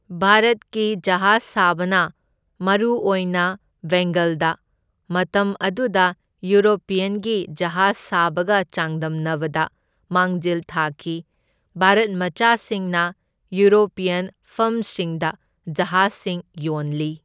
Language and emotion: Manipuri, neutral